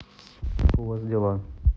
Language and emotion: Russian, neutral